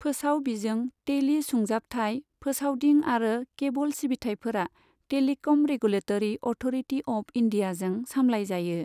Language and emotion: Bodo, neutral